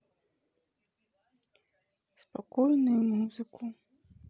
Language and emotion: Russian, sad